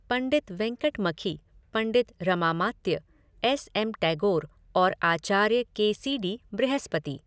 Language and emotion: Hindi, neutral